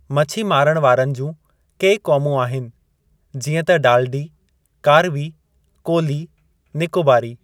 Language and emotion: Sindhi, neutral